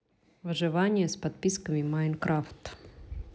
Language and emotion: Russian, neutral